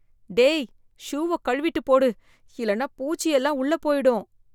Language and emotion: Tamil, fearful